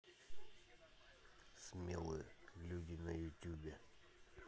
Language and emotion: Russian, neutral